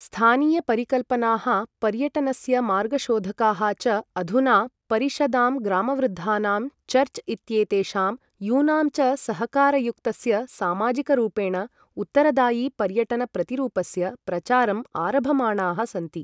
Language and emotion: Sanskrit, neutral